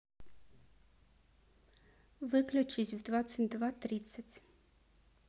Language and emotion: Russian, neutral